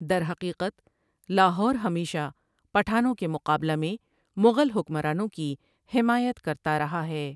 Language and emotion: Urdu, neutral